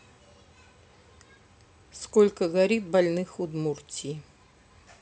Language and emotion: Russian, neutral